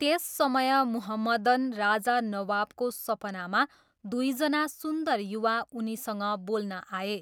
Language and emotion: Nepali, neutral